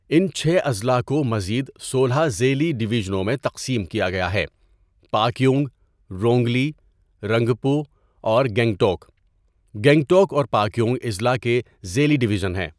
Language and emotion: Urdu, neutral